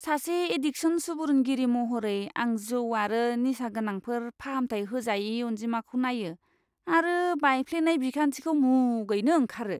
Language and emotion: Bodo, disgusted